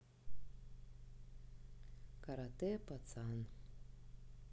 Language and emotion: Russian, neutral